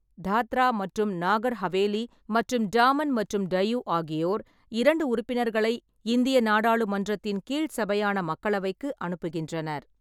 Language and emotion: Tamil, neutral